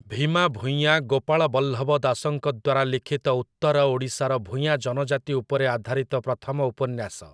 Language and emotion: Odia, neutral